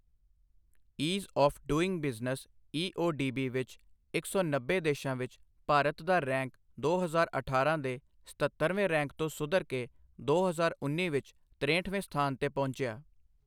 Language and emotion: Punjabi, neutral